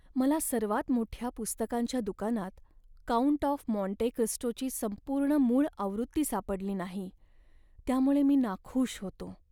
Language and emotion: Marathi, sad